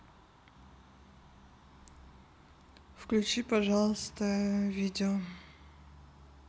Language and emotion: Russian, neutral